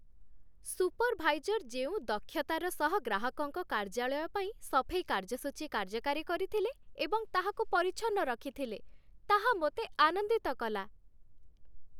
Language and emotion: Odia, happy